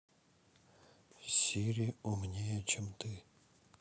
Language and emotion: Russian, sad